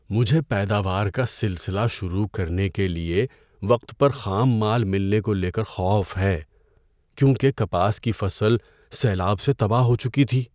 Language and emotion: Urdu, fearful